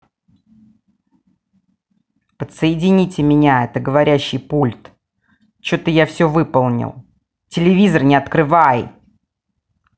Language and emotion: Russian, angry